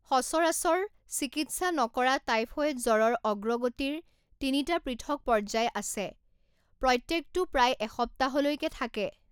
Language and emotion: Assamese, neutral